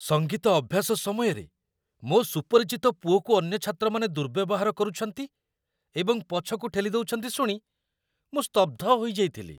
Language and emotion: Odia, surprised